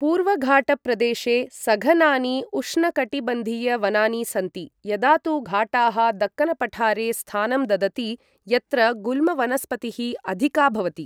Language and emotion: Sanskrit, neutral